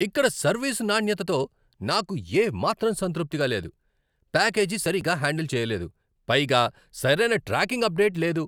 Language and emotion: Telugu, angry